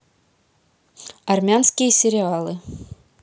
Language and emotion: Russian, neutral